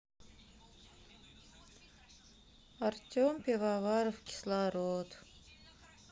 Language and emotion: Russian, sad